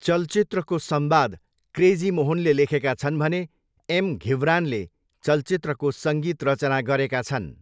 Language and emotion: Nepali, neutral